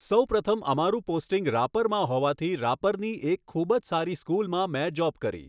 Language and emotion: Gujarati, neutral